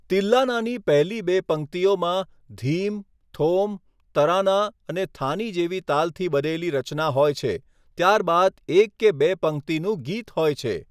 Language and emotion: Gujarati, neutral